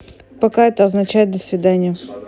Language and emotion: Russian, neutral